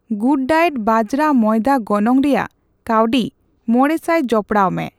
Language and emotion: Santali, neutral